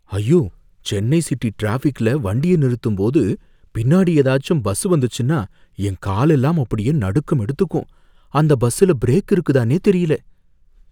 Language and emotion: Tamil, fearful